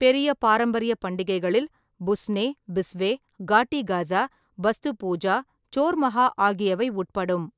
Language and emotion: Tamil, neutral